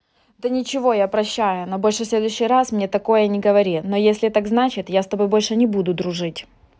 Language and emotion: Russian, angry